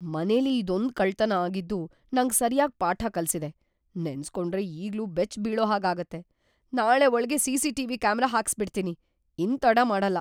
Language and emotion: Kannada, fearful